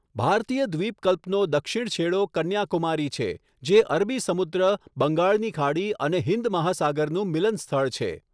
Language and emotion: Gujarati, neutral